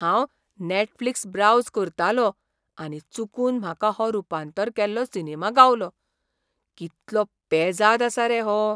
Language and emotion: Goan Konkani, surprised